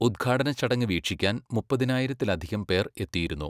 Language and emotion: Malayalam, neutral